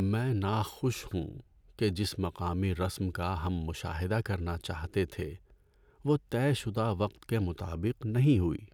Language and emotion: Urdu, sad